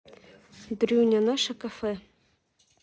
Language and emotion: Russian, neutral